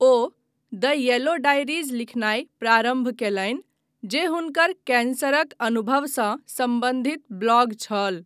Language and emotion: Maithili, neutral